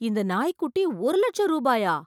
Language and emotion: Tamil, surprised